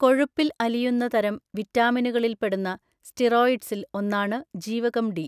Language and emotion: Malayalam, neutral